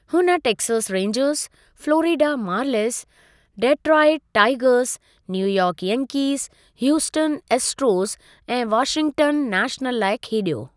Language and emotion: Sindhi, neutral